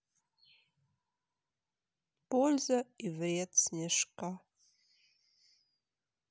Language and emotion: Russian, sad